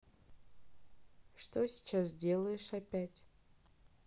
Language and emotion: Russian, neutral